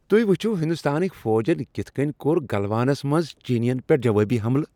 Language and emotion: Kashmiri, happy